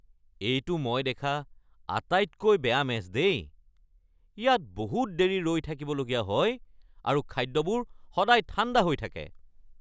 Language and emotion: Assamese, angry